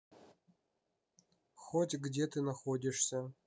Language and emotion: Russian, neutral